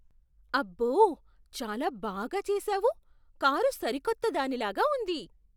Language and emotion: Telugu, surprised